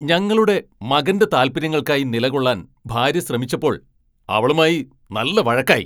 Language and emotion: Malayalam, angry